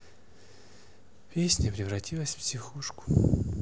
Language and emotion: Russian, sad